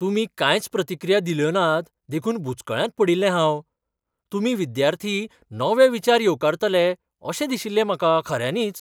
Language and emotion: Goan Konkani, surprised